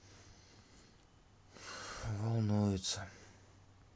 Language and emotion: Russian, sad